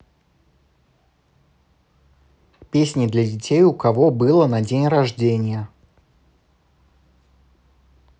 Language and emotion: Russian, neutral